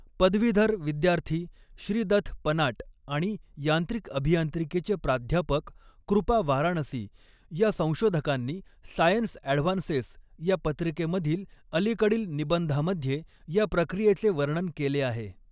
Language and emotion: Marathi, neutral